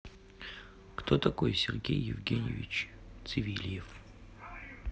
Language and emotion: Russian, neutral